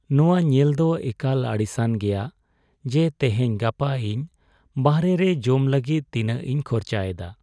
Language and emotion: Santali, sad